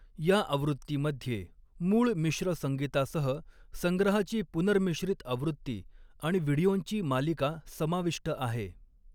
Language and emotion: Marathi, neutral